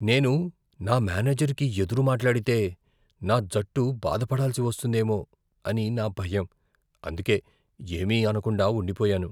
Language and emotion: Telugu, fearful